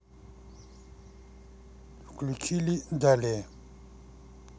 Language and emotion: Russian, neutral